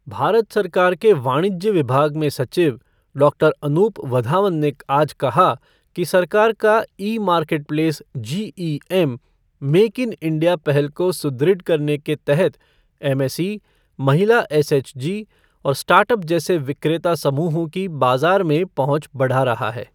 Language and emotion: Hindi, neutral